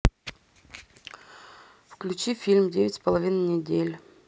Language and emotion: Russian, neutral